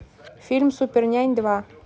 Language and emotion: Russian, neutral